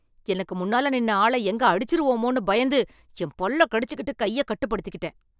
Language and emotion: Tamil, angry